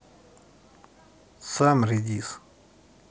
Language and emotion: Russian, neutral